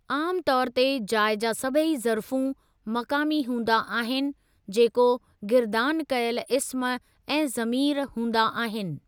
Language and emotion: Sindhi, neutral